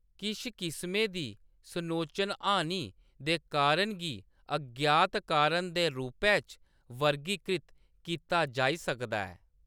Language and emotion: Dogri, neutral